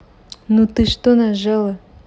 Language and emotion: Russian, angry